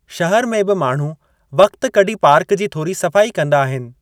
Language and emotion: Sindhi, neutral